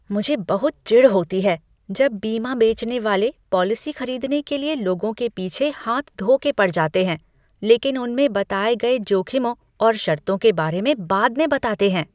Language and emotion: Hindi, disgusted